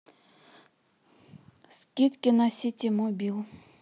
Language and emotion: Russian, neutral